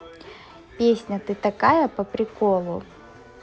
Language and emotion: Russian, positive